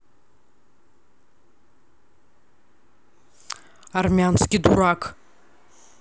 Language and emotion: Russian, angry